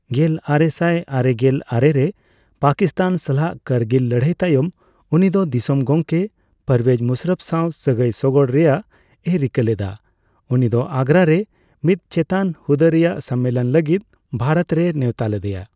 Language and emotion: Santali, neutral